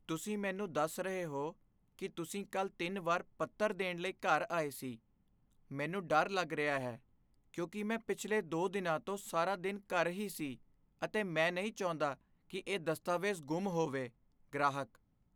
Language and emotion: Punjabi, fearful